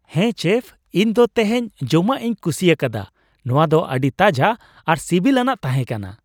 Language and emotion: Santali, happy